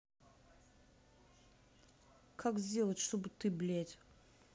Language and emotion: Russian, angry